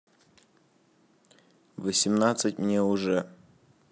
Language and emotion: Russian, neutral